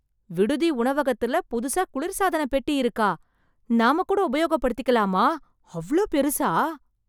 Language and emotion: Tamil, surprised